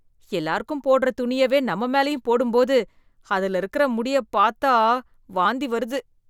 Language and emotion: Tamil, disgusted